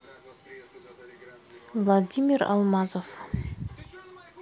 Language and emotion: Russian, neutral